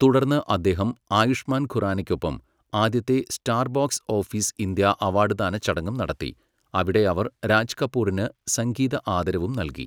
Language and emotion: Malayalam, neutral